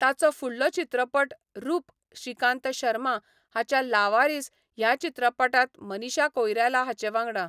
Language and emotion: Goan Konkani, neutral